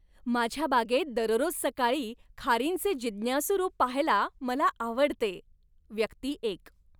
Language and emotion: Marathi, happy